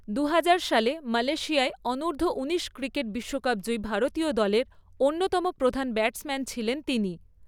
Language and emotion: Bengali, neutral